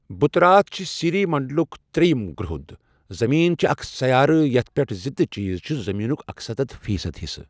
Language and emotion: Kashmiri, neutral